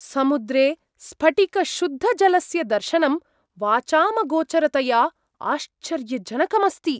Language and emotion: Sanskrit, surprised